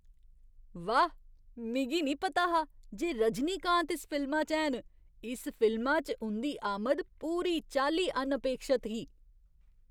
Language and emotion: Dogri, surprised